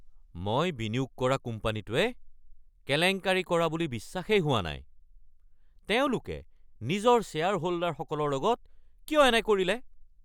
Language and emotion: Assamese, angry